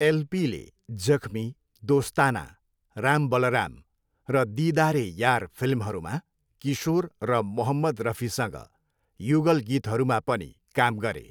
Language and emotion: Nepali, neutral